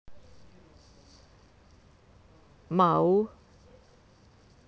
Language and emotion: Russian, neutral